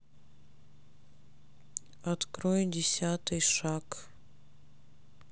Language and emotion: Russian, sad